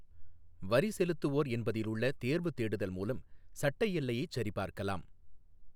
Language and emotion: Tamil, neutral